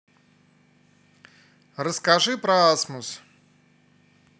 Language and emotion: Russian, positive